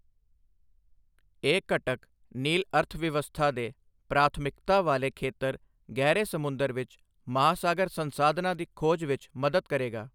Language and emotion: Punjabi, neutral